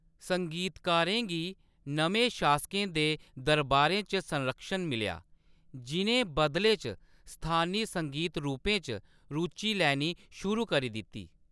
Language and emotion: Dogri, neutral